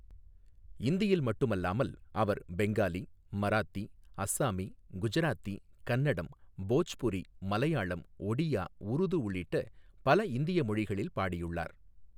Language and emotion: Tamil, neutral